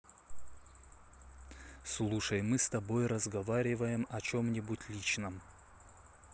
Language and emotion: Russian, neutral